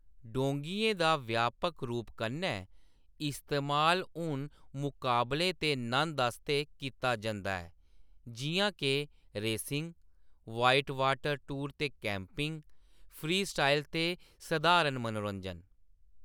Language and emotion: Dogri, neutral